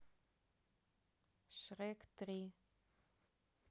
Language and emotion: Russian, neutral